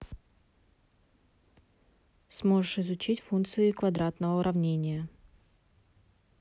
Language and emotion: Russian, neutral